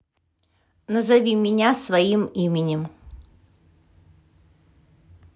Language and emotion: Russian, neutral